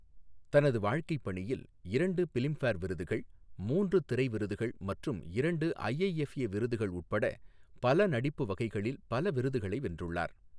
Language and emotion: Tamil, neutral